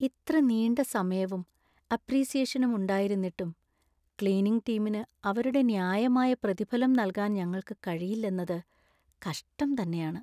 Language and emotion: Malayalam, sad